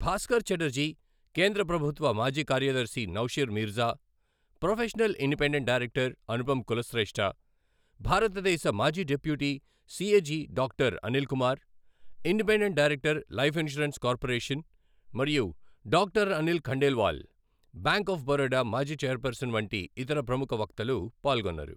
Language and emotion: Telugu, neutral